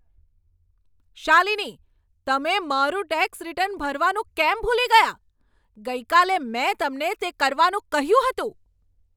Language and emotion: Gujarati, angry